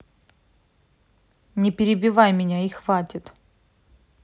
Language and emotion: Russian, angry